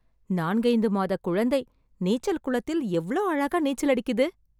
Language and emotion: Tamil, surprised